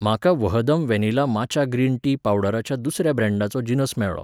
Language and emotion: Goan Konkani, neutral